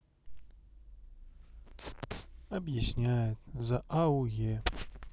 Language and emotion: Russian, sad